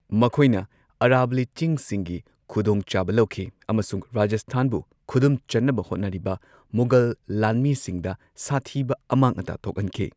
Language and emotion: Manipuri, neutral